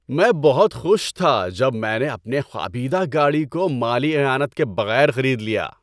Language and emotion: Urdu, happy